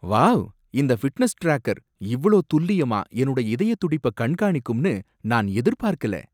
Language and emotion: Tamil, surprised